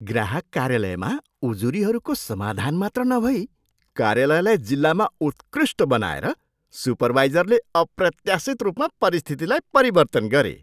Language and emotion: Nepali, surprised